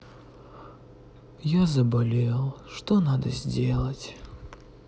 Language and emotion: Russian, sad